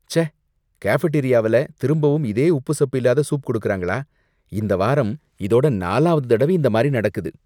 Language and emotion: Tamil, disgusted